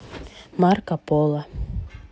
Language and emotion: Russian, neutral